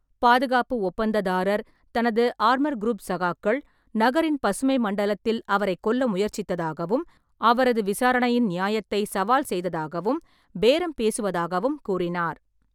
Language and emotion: Tamil, neutral